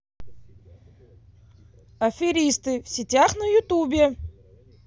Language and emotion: Russian, angry